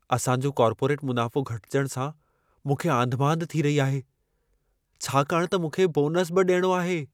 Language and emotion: Sindhi, fearful